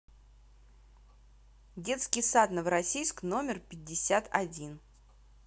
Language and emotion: Russian, neutral